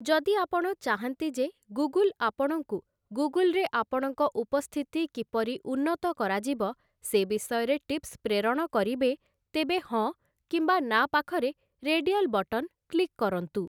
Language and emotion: Odia, neutral